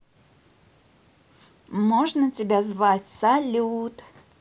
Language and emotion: Russian, positive